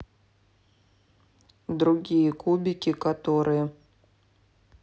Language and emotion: Russian, neutral